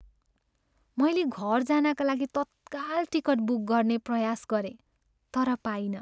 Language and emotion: Nepali, sad